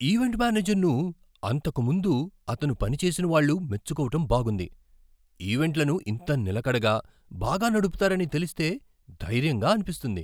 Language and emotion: Telugu, surprised